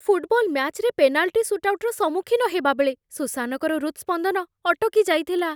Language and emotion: Odia, fearful